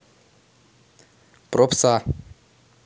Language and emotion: Russian, neutral